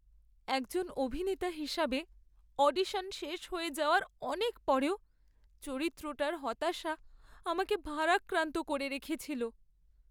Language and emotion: Bengali, sad